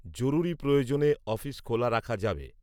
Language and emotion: Bengali, neutral